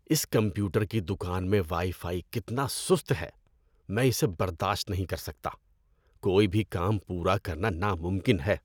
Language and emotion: Urdu, disgusted